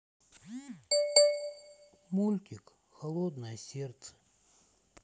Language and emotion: Russian, sad